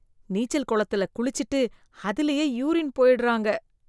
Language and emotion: Tamil, disgusted